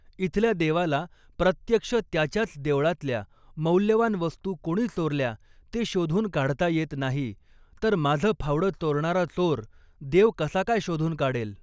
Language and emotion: Marathi, neutral